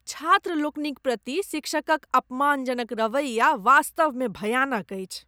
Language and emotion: Maithili, disgusted